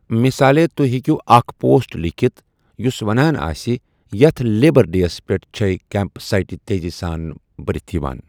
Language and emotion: Kashmiri, neutral